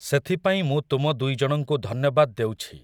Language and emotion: Odia, neutral